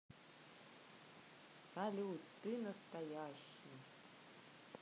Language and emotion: Russian, neutral